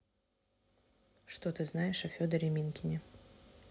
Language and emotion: Russian, neutral